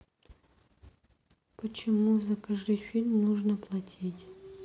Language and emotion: Russian, sad